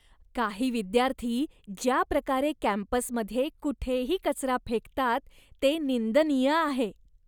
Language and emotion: Marathi, disgusted